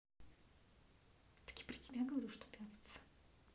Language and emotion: Russian, angry